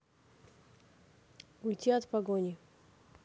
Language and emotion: Russian, neutral